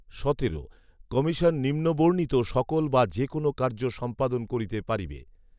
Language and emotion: Bengali, neutral